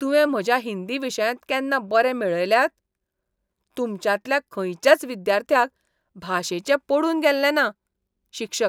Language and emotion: Goan Konkani, disgusted